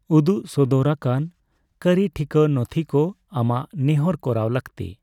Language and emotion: Santali, neutral